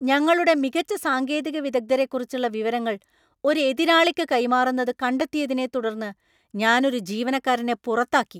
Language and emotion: Malayalam, angry